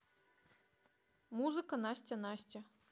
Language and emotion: Russian, neutral